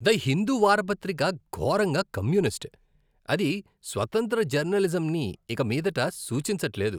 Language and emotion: Telugu, disgusted